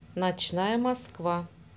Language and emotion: Russian, neutral